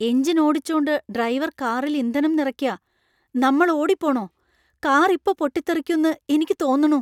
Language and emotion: Malayalam, fearful